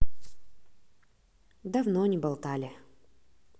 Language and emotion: Russian, neutral